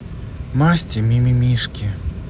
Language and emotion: Russian, neutral